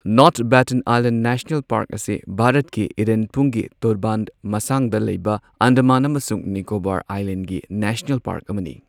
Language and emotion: Manipuri, neutral